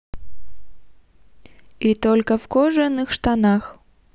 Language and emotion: Russian, positive